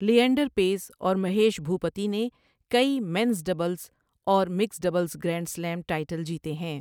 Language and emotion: Urdu, neutral